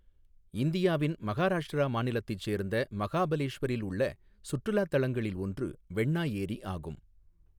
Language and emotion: Tamil, neutral